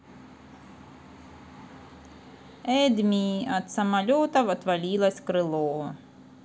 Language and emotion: Russian, neutral